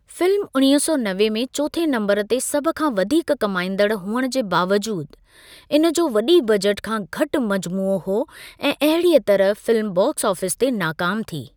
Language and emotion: Sindhi, neutral